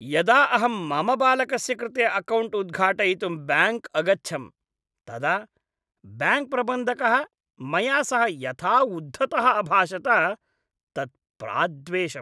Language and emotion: Sanskrit, disgusted